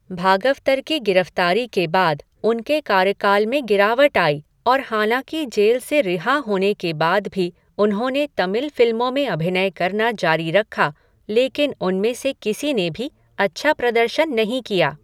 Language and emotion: Hindi, neutral